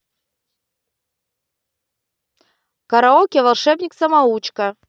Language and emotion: Russian, positive